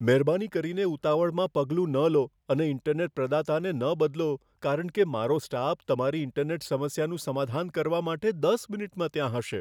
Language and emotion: Gujarati, fearful